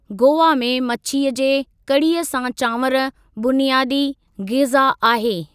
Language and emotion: Sindhi, neutral